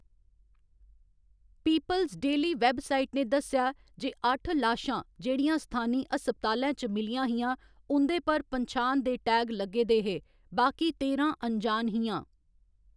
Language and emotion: Dogri, neutral